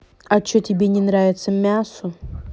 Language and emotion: Russian, angry